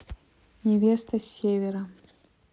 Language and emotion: Russian, neutral